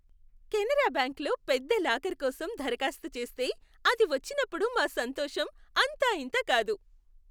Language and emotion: Telugu, happy